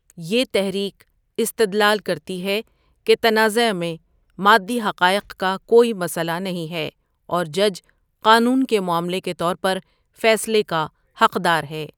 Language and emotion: Urdu, neutral